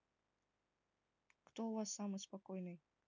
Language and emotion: Russian, neutral